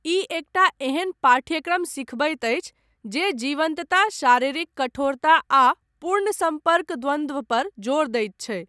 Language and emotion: Maithili, neutral